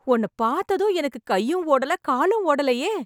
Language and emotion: Tamil, happy